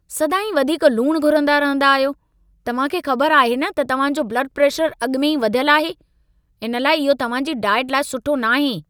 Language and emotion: Sindhi, angry